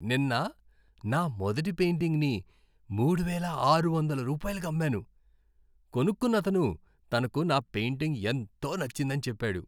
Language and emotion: Telugu, happy